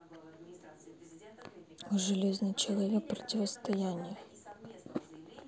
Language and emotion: Russian, neutral